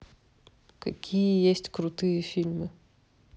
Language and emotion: Russian, neutral